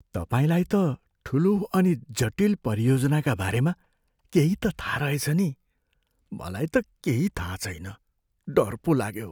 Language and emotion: Nepali, fearful